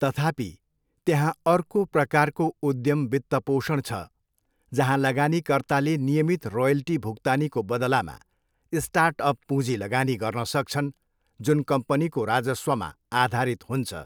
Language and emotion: Nepali, neutral